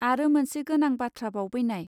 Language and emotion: Bodo, neutral